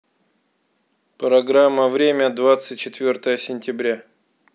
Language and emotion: Russian, neutral